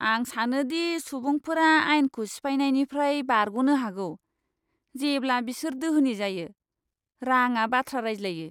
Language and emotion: Bodo, disgusted